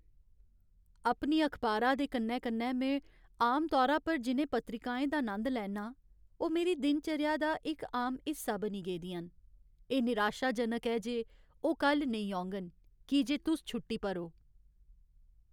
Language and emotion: Dogri, sad